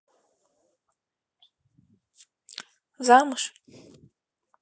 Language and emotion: Russian, neutral